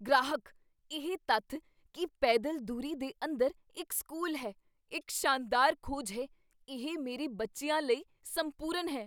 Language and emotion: Punjabi, surprised